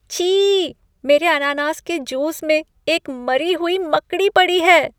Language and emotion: Hindi, disgusted